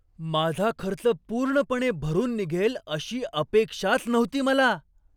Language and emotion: Marathi, surprised